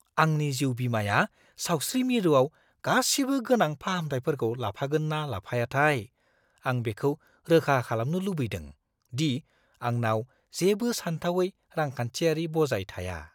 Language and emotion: Bodo, fearful